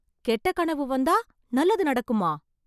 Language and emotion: Tamil, surprised